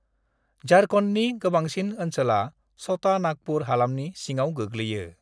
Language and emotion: Bodo, neutral